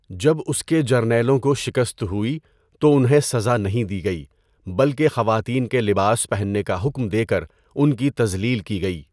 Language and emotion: Urdu, neutral